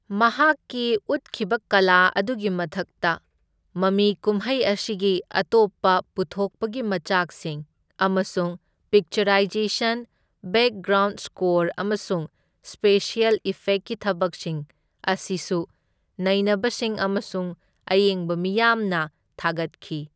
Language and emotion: Manipuri, neutral